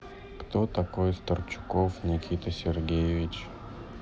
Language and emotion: Russian, sad